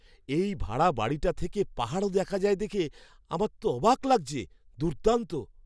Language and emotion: Bengali, surprised